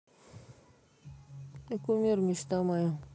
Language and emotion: Russian, neutral